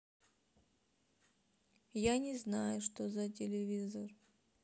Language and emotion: Russian, sad